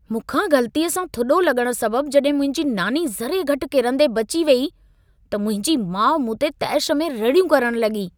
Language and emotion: Sindhi, angry